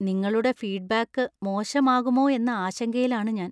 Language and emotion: Malayalam, fearful